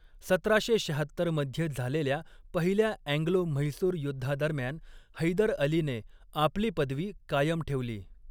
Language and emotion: Marathi, neutral